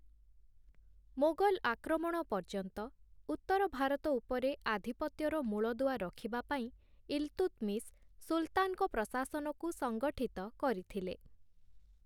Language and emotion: Odia, neutral